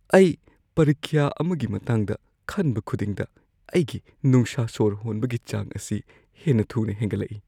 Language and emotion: Manipuri, fearful